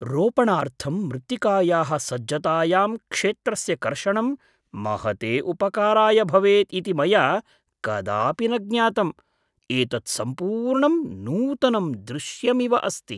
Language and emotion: Sanskrit, surprised